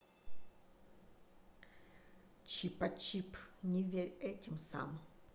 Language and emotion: Russian, neutral